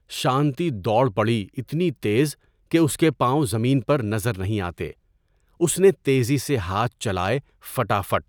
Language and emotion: Urdu, neutral